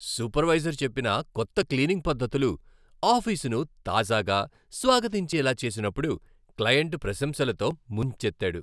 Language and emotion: Telugu, happy